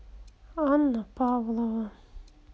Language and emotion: Russian, sad